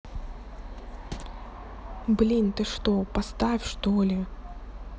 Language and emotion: Russian, neutral